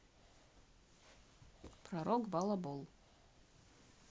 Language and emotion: Russian, neutral